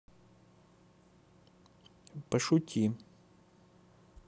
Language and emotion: Russian, neutral